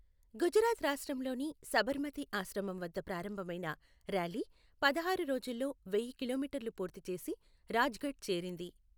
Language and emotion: Telugu, neutral